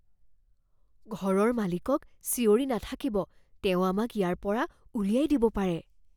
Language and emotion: Assamese, fearful